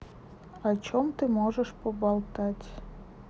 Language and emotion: Russian, neutral